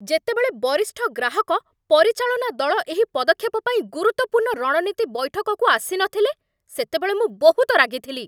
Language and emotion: Odia, angry